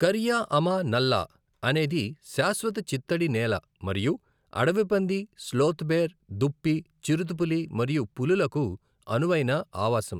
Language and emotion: Telugu, neutral